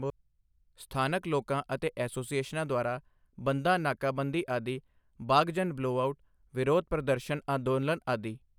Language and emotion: Punjabi, neutral